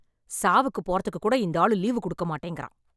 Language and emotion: Tamil, angry